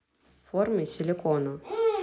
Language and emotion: Russian, neutral